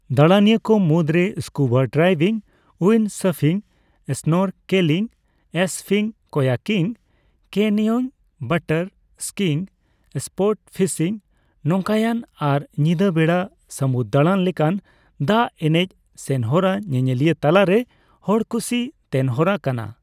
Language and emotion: Santali, neutral